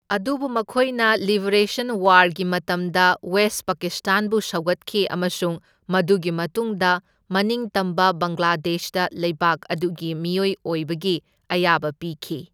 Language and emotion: Manipuri, neutral